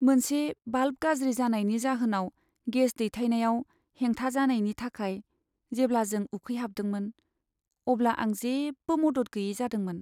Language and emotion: Bodo, sad